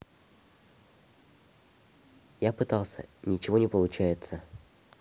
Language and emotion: Russian, neutral